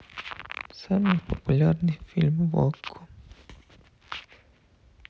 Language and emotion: Russian, sad